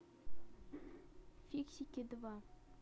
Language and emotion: Russian, neutral